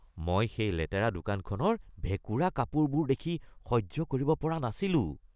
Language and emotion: Assamese, disgusted